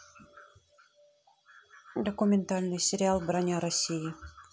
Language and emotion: Russian, neutral